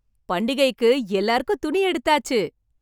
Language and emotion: Tamil, happy